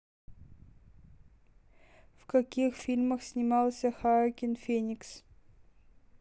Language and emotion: Russian, neutral